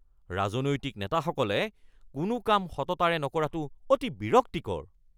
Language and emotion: Assamese, angry